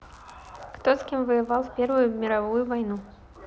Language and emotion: Russian, neutral